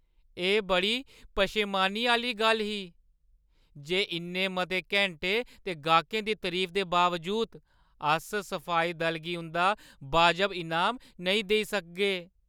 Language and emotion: Dogri, sad